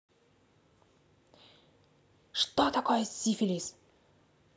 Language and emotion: Russian, neutral